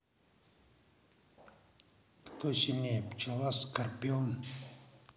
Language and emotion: Russian, neutral